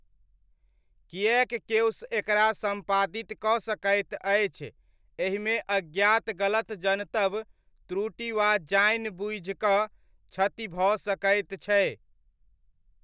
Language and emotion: Maithili, neutral